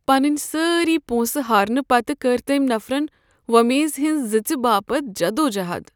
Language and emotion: Kashmiri, sad